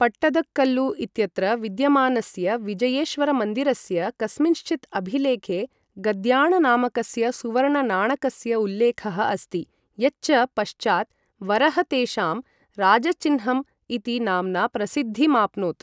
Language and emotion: Sanskrit, neutral